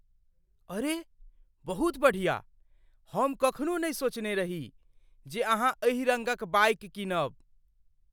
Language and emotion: Maithili, surprised